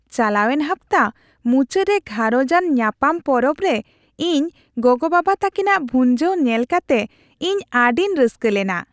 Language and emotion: Santali, happy